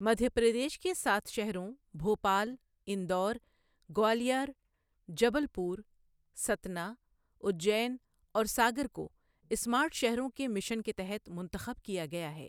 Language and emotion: Urdu, neutral